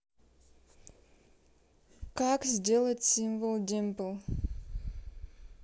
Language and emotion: Russian, neutral